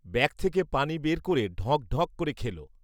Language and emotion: Bengali, neutral